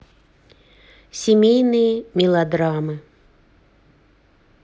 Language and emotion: Russian, neutral